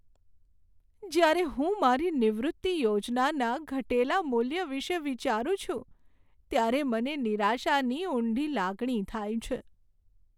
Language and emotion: Gujarati, sad